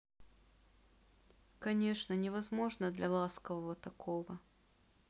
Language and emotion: Russian, sad